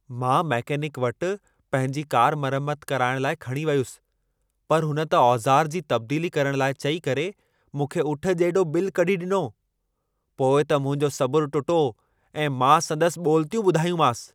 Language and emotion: Sindhi, angry